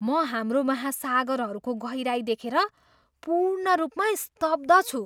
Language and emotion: Nepali, surprised